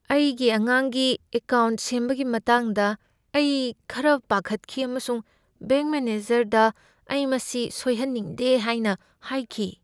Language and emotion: Manipuri, fearful